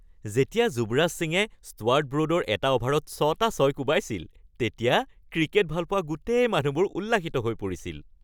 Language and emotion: Assamese, happy